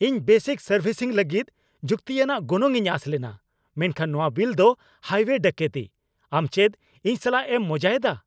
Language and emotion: Santali, angry